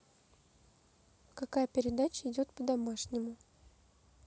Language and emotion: Russian, neutral